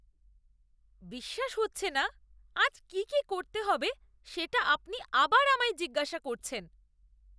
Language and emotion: Bengali, disgusted